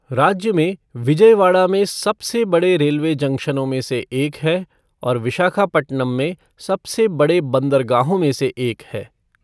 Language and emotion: Hindi, neutral